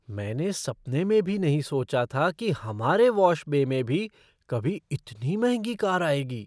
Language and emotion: Hindi, surprised